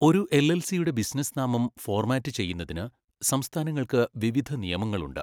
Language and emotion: Malayalam, neutral